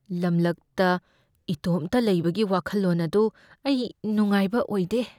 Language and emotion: Manipuri, fearful